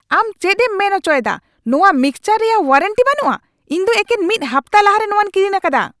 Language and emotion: Santali, angry